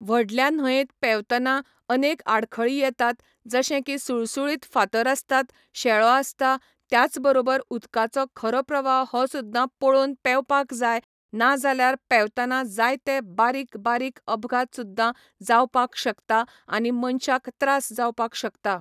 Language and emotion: Goan Konkani, neutral